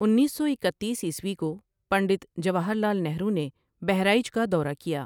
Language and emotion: Urdu, neutral